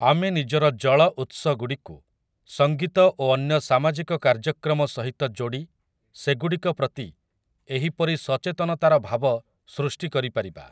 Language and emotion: Odia, neutral